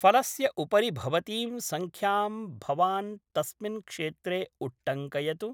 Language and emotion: Sanskrit, neutral